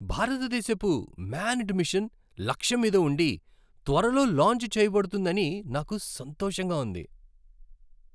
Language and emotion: Telugu, happy